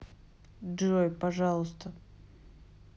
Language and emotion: Russian, neutral